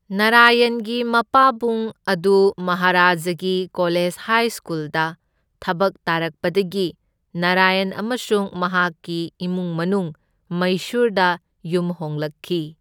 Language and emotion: Manipuri, neutral